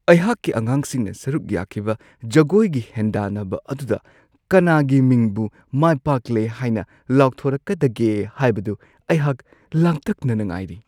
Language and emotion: Manipuri, surprised